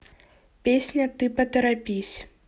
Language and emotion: Russian, neutral